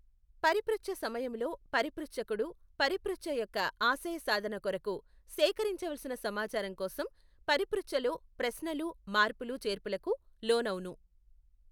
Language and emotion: Telugu, neutral